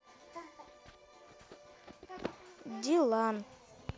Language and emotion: Russian, neutral